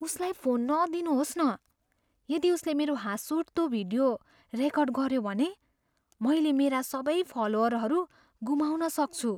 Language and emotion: Nepali, fearful